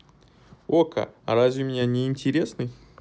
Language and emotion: Russian, neutral